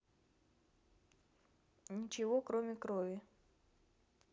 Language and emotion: Russian, neutral